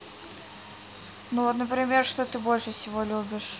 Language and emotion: Russian, neutral